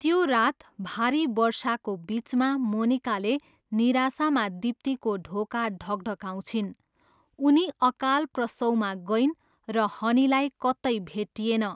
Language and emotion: Nepali, neutral